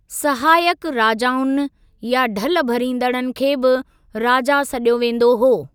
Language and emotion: Sindhi, neutral